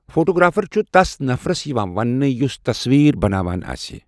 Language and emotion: Kashmiri, neutral